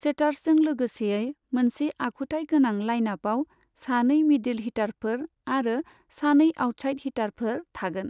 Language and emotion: Bodo, neutral